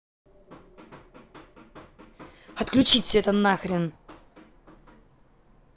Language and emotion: Russian, angry